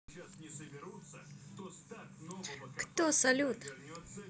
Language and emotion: Russian, positive